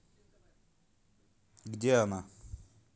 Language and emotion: Russian, neutral